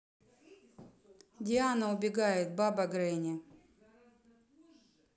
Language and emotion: Russian, neutral